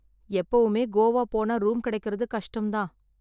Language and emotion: Tamil, sad